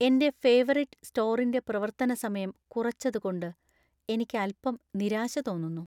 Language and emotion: Malayalam, sad